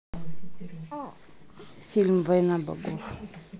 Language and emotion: Russian, neutral